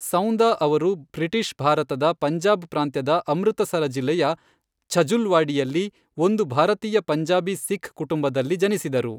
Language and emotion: Kannada, neutral